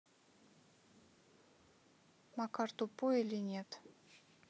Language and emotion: Russian, neutral